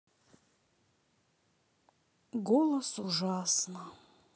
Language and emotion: Russian, sad